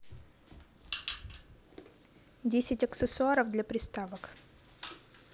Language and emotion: Russian, neutral